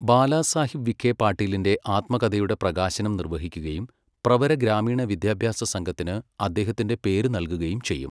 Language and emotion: Malayalam, neutral